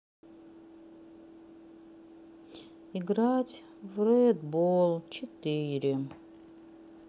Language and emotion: Russian, sad